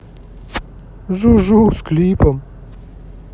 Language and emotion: Russian, positive